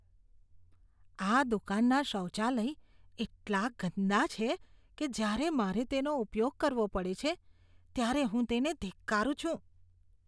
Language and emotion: Gujarati, disgusted